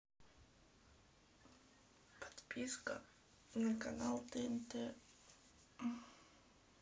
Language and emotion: Russian, sad